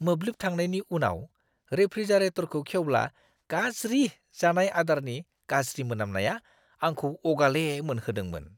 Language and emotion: Bodo, disgusted